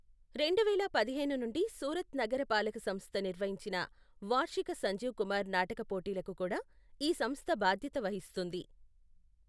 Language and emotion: Telugu, neutral